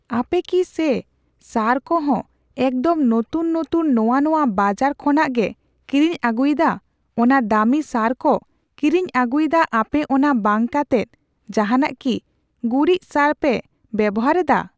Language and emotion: Santali, neutral